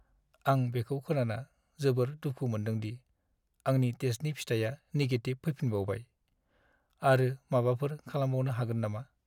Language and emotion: Bodo, sad